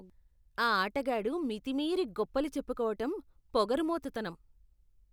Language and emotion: Telugu, disgusted